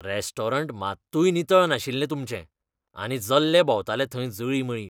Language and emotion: Goan Konkani, disgusted